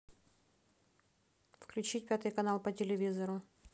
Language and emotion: Russian, neutral